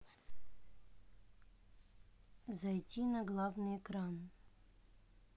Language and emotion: Russian, neutral